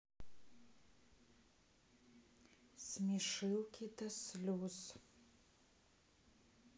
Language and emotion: Russian, sad